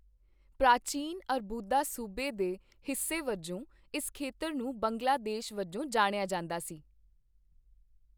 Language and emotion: Punjabi, neutral